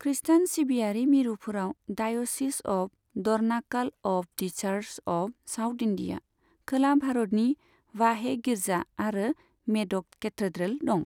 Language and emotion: Bodo, neutral